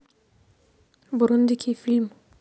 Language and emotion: Russian, neutral